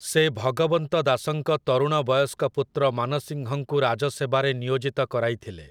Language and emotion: Odia, neutral